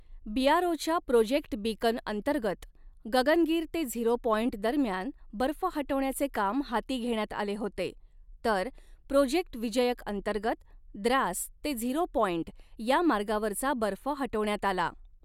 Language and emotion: Marathi, neutral